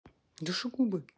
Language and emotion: Russian, neutral